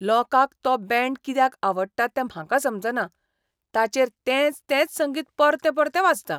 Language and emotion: Goan Konkani, disgusted